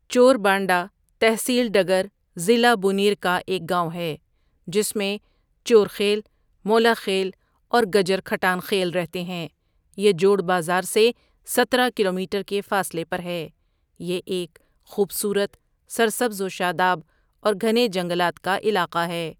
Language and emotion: Urdu, neutral